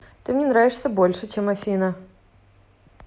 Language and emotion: Russian, positive